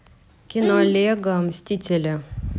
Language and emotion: Russian, neutral